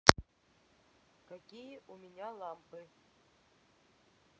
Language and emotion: Russian, neutral